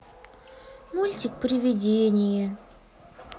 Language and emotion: Russian, sad